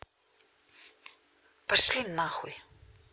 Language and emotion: Russian, angry